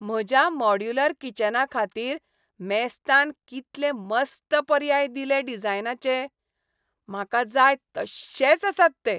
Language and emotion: Goan Konkani, happy